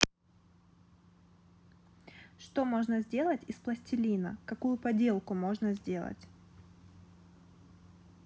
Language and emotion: Russian, neutral